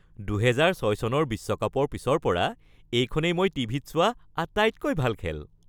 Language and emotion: Assamese, happy